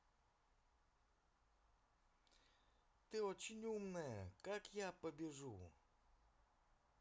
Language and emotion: Russian, positive